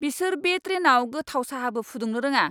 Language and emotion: Bodo, angry